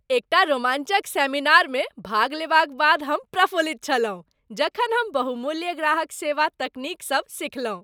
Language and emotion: Maithili, happy